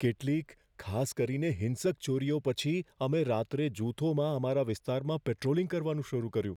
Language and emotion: Gujarati, fearful